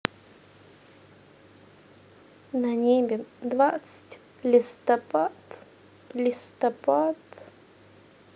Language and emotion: Russian, sad